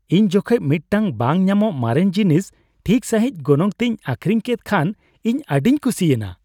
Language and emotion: Santali, happy